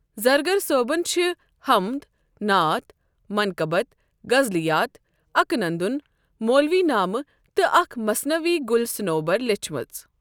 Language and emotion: Kashmiri, neutral